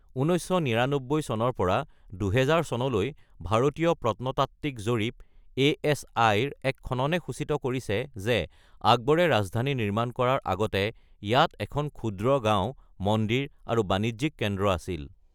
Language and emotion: Assamese, neutral